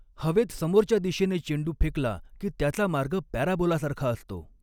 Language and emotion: Marathi, neutral